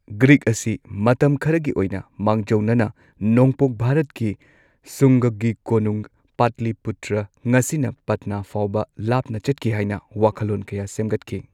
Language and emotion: Manipuri, neutral